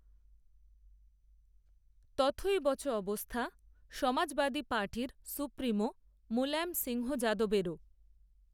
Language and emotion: Bengali, neutral